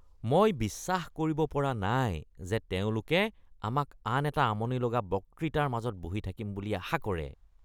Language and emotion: Assamese, disgusted